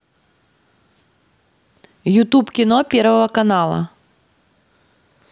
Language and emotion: Russian, neutral